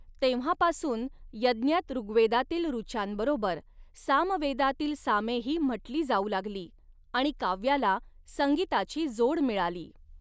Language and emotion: Marathi, neutral